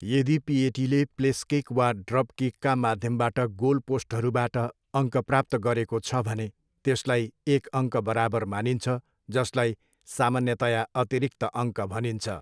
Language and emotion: Nepali, neutral